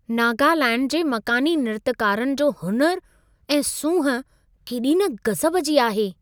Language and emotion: Sindhi, surprised